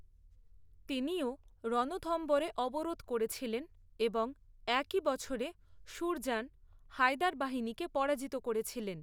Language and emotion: Bengali, neutral